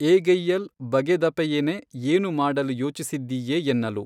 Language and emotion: Kannada, neutral